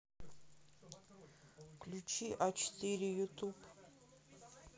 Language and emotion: Russian, sad